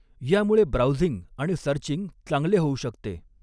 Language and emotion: Marathi, neutral